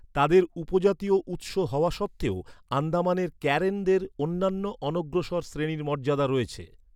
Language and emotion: Bengali, neutral